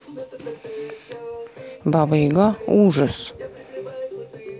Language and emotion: Russian, neutral